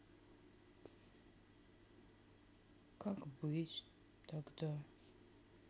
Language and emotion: Russian, sad